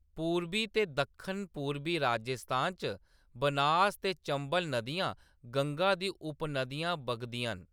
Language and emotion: Dogri, neutral